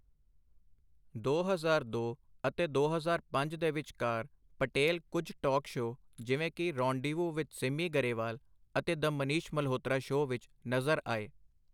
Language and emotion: Punjabi, neutral